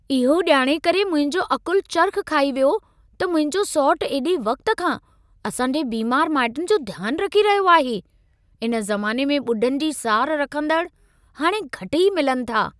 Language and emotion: Sindhi, surprised